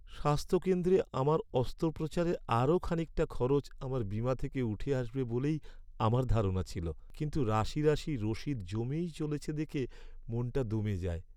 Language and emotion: Bengali, sad